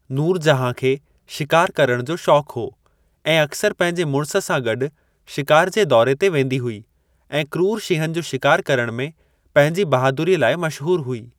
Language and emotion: Sindhi, neutral